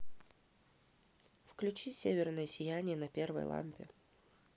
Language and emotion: Russian, neutral